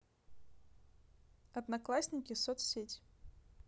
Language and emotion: Russian, neutral